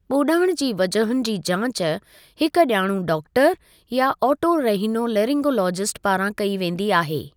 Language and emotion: Sindhi, neutral